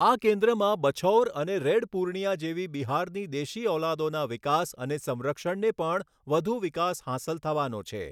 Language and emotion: Gujarati, neutral